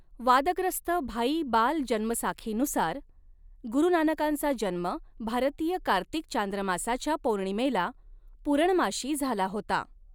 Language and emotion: Marathi, neutral